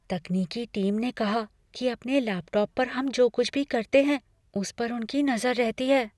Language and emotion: Hindi, fearful